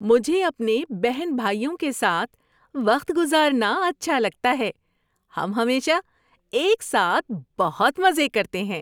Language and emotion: Urdu, happy